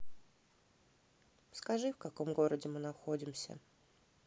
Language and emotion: Russian, sad